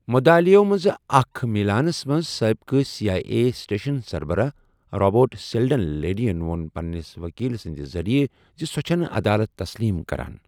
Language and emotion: Kashmiri, neutral